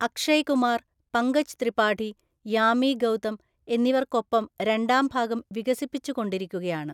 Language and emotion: Malayalam, neutral